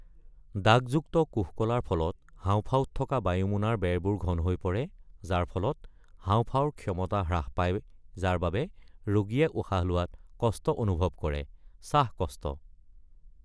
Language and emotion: Assamese, neutral